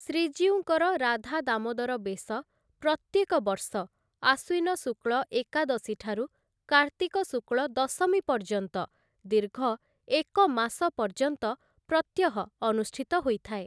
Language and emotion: Odia, neutral